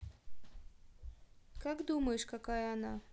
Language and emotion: Russian, neutral